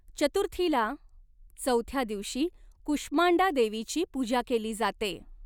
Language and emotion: Marathi, neutral